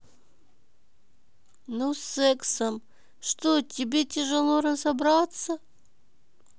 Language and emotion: Russian, neutral